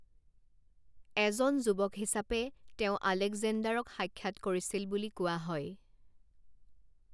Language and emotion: Assamese, neutral